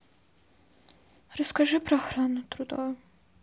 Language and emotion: Russian, sad